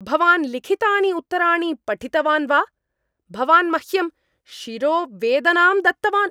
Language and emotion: Sanskrit, angry